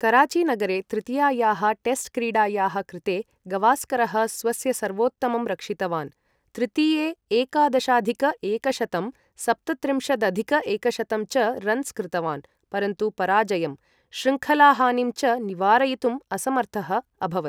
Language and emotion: Sanskrit, neutral